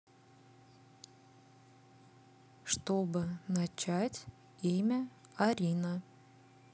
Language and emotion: Russian, neutral